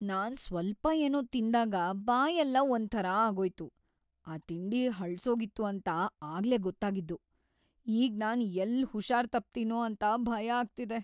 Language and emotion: Kannada, fearful